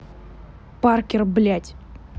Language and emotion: Russian, angry